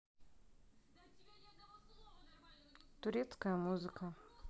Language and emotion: Russian, neutral